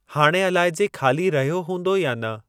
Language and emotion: Sindhi, neutral